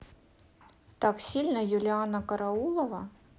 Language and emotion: Russian, neutral